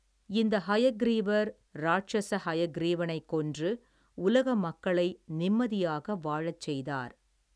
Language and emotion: Tamil, neutral